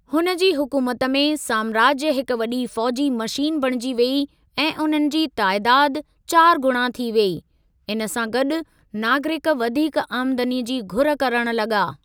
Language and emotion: Sindhi, neutral